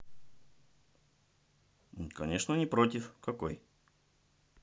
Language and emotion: Russian, neutral